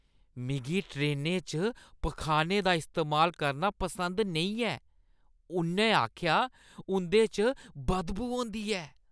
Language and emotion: Dogri, disgusted